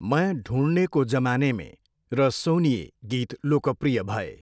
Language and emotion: Nepali, neutral